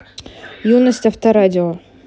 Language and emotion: Russian, neutral